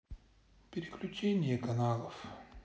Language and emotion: Russian, sad